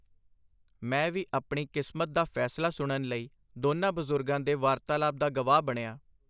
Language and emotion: Punjabi, neutral